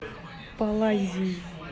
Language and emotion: Russian, neutral